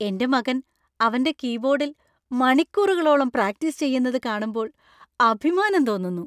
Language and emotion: Malayalam, happy